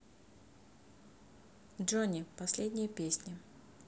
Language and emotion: Russian, neutral